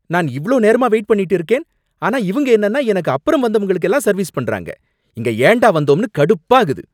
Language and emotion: Tamil, angry